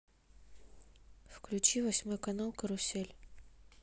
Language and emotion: Russian, neutral